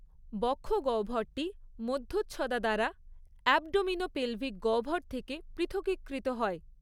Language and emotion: Bengali, neutral